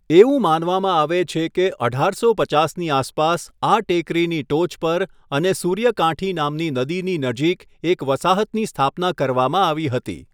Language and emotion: Gujarati, neutral